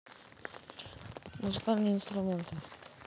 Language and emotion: Russian, neutral